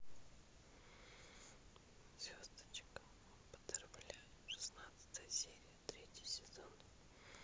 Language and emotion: Russian, neutral